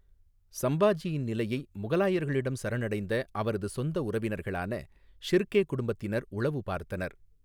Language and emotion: Tamil, neutral